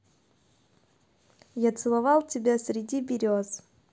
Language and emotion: Russian, positive